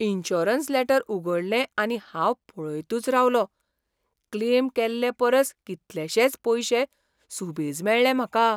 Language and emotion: Goan Konkani, surprised